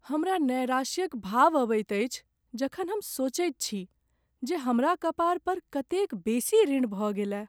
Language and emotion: Maithili, sad